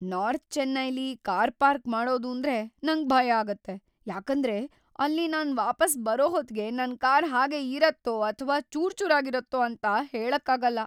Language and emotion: Kannada, fearful